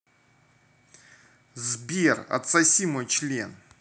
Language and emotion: Russian, angry